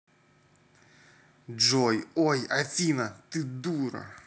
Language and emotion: Russian, angry